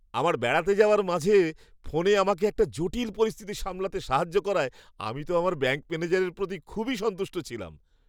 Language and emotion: Bengali, happy